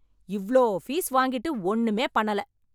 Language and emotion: Tamil, angry